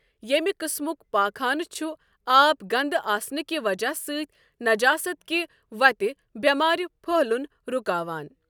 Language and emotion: Kashmiri, neutral